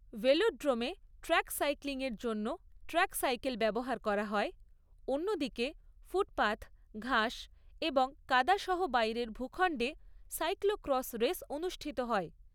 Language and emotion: Bengali, neutral